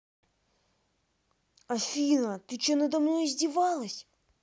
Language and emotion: Russian, angry